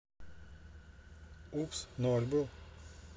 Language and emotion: Russian, neutral